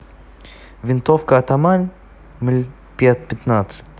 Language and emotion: Russian, neutral